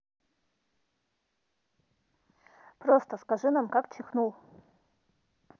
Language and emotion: Russian, neutral